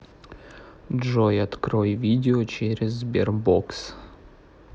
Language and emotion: Russian, neutral